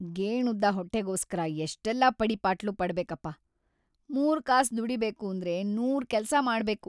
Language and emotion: Kannada, sad